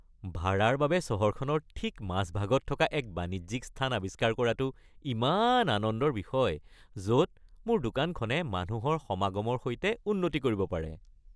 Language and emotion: Assamese, happy